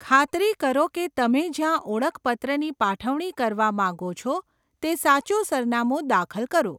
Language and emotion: Gujarati, neutral